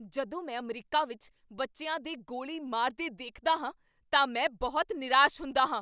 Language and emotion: Punjabi, angry